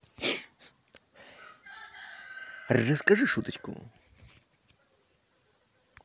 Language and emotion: Russian, positive